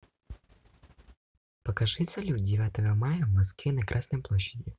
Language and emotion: Russian, neutral